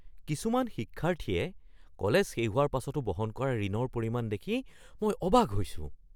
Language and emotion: Assamese, surprised